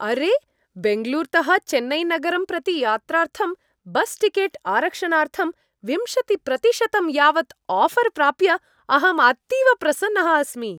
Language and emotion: Sanskrit, happy